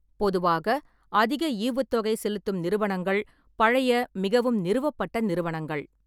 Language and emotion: Tamil, neutral